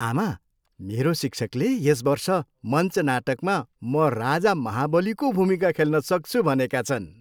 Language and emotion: Nepali, happy